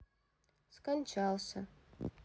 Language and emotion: Russian, sad